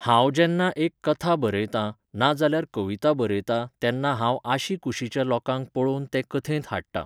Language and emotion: Goan Konkani, neutral